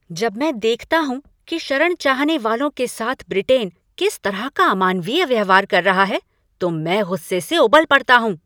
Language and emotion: Hindi, angry